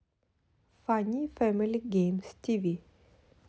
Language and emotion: Russian, neutral